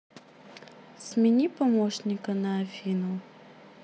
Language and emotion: Russian, neutral